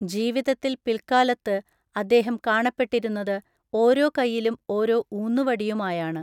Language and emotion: Malayalam, neutral